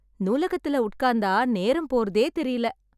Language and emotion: Tamil, happy